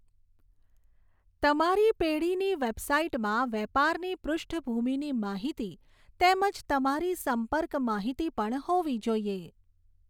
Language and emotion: Gujarati, neutral